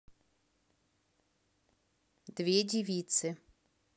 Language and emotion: Russian, neutral